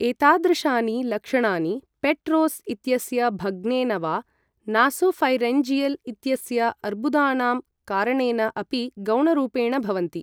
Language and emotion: Sanskrit, neutral